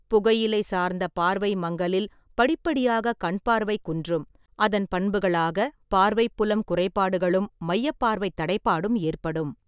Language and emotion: Tamil, neutral